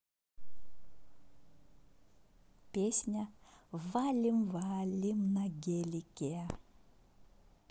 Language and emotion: Russian, positive